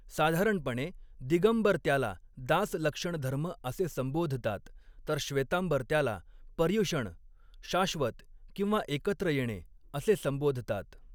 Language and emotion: Marathi, neutral